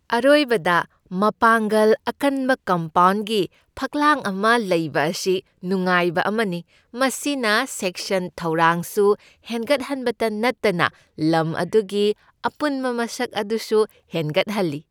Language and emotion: Manipuri, happy